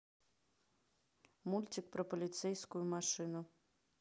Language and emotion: Russian, neutral